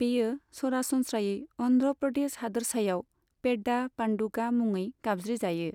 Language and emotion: Bodo, neutral